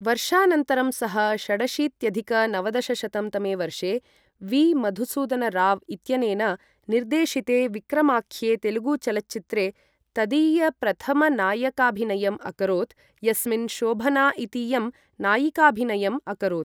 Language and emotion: Sanskrit, neutral